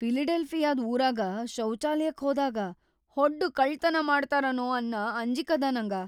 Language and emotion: Kannada, fearful